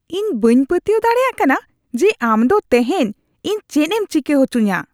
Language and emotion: Santali, disgusted